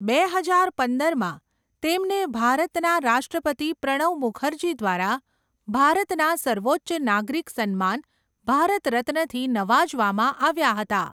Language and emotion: Gujarati, neutral